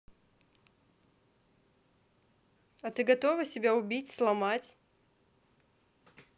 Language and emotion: Russian, neutral